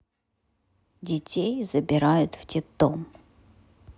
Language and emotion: Russian, neutral